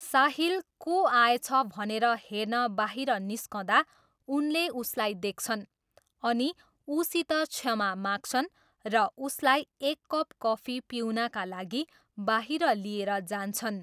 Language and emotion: Nepali, neutral